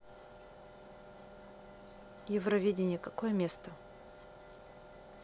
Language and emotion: Russian, neutral